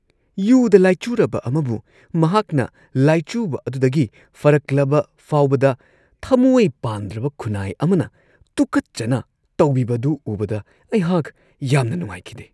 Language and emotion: Manipuri, disgusted